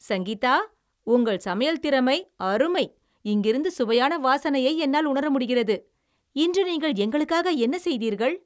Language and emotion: Tamil, happy